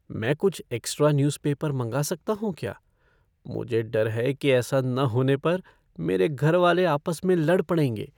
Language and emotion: Hindi, fearful